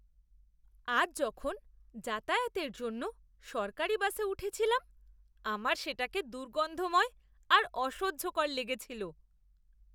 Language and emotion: Bengali, disgusted